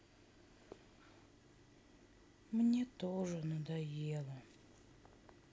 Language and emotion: Russian, sad